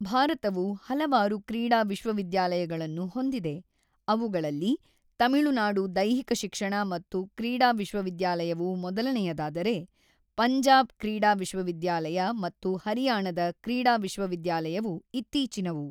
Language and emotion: Kannada, neutral